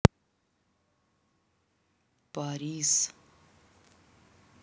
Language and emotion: Russian, neutral